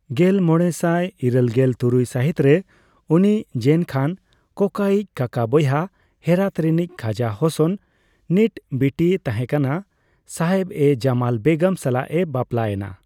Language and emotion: Santali, neutral